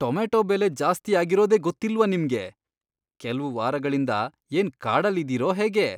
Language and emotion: Kannada, disgusted